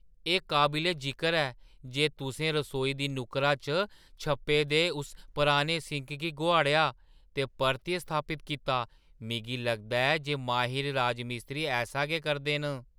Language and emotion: Dogri, surprised